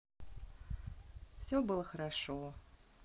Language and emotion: Russian, neutral